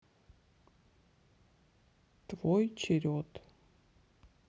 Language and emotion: Russian, sad